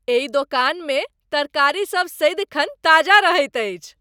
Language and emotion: Maithili, happy